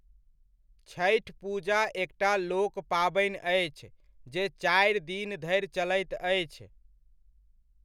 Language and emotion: Maithili, neutral